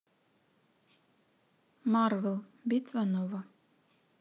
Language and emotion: Russian, neutral